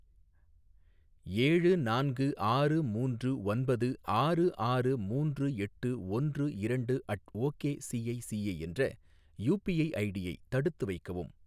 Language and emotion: Tamil, neutral